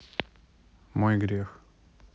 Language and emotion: Russian, neutral